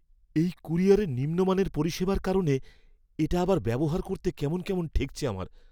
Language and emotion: Bengali, fearful